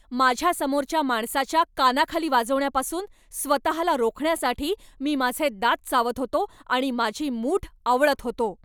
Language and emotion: Marathi, angry